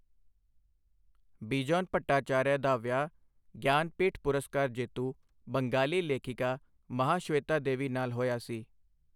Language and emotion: Punjabi, neutral